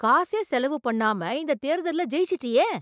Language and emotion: Tamil, surprised